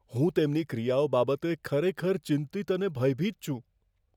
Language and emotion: Gujarati, fearful